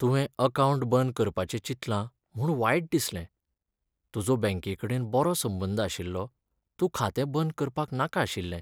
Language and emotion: Goan Konkani, sad